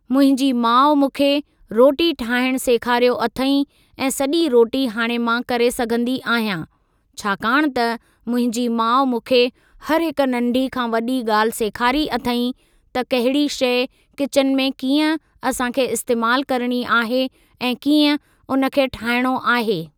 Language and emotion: Sindhi, neutral